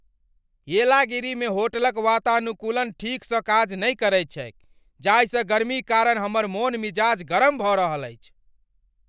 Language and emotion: Maithili, angry